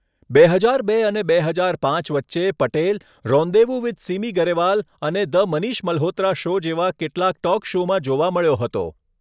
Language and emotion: Gujarati, neutral